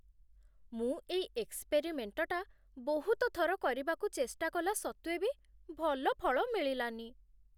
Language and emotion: Odia, sad